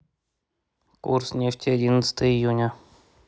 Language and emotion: Russian, neutral